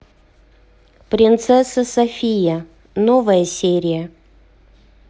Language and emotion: Russian, neutral